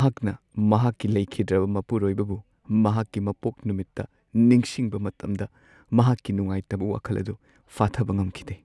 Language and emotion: Manipuri, sad